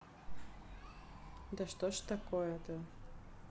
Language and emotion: Russian, sad